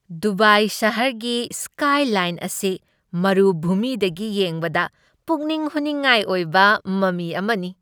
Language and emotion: Manipuri, happy